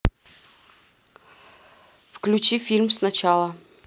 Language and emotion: Russian, neutral